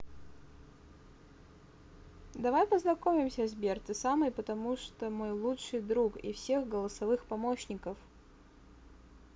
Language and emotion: Russian, positive